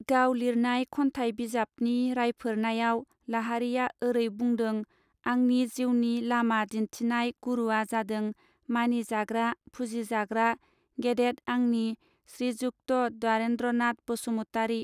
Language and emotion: Bodo, neutral